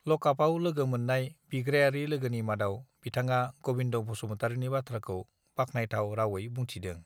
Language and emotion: Bodo, neutral